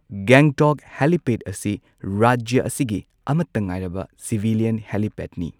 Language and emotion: Manipuri, neutral